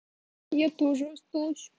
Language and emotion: Russian, sad